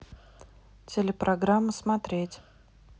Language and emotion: Russian, neutral